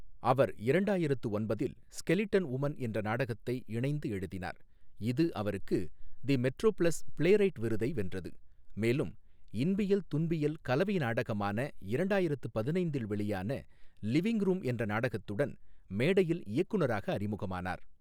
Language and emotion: Tamil, neutral